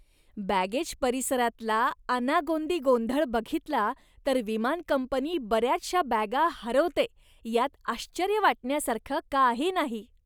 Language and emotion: Marathi, disgusted